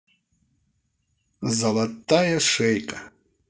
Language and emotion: Russian, positive